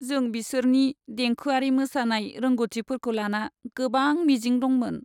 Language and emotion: Bodo, sad